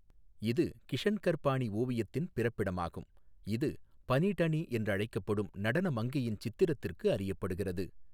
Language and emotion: Tamil, neutral